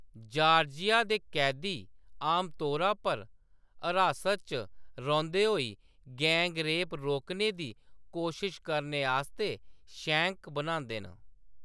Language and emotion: Dogri, neutral